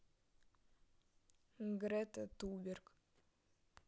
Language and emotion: Russian, neutral